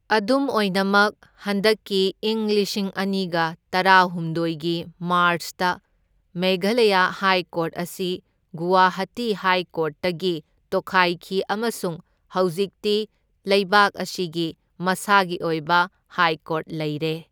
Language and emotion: Manipuri, neutral